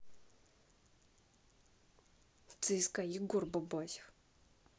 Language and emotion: Russian, angry